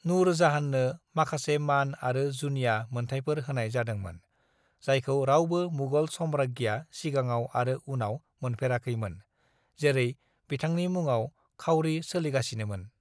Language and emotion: Bodo, neutral